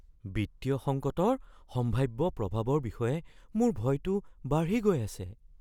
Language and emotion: Assamese, fearful